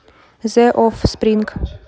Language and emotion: Russian, neutral